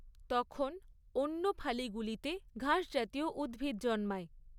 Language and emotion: Bengali, neutral